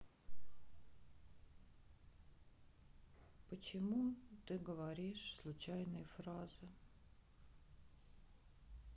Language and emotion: Russian, sad